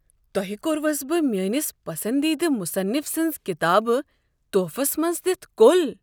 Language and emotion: Kashmiri, surprised